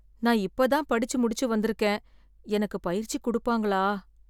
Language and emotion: Tamil, fearful